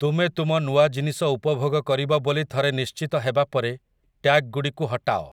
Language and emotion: Odia, neutral